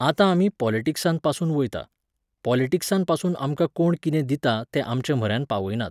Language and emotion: Goan Konkani, neutral